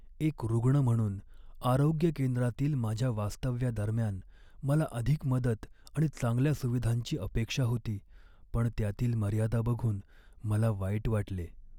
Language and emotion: Marathi, sad